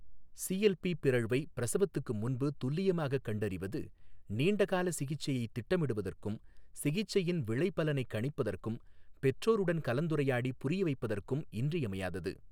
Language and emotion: Tamil, neutral